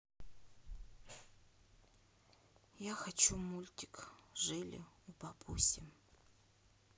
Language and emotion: Russian, sad